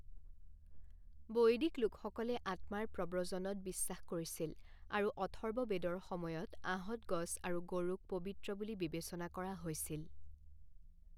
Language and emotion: Assamese, neutral